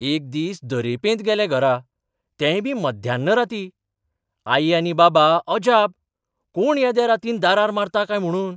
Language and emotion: Goan Konkani, surprised